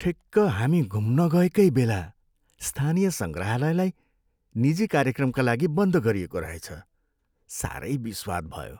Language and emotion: Nepali, sad